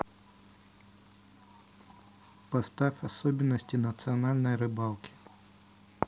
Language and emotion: Russian, neutral